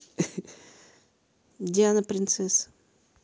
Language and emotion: Russian, neutral